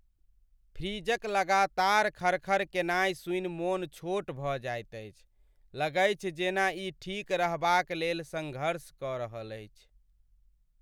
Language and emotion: Maithili, sad